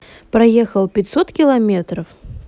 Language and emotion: Russian, neutral